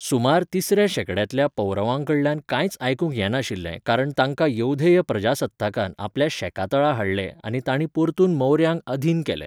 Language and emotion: Goan Konkani, neutral